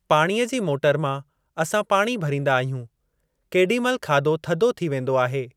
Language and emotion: Sindhi, neutral